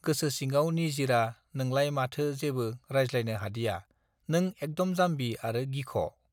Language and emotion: Bodo, neutral